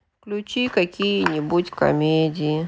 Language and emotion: Russian, sad